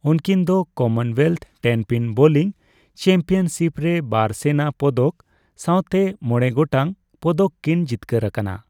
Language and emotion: Santali, neutral